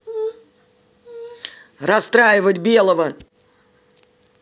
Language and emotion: Russian, angry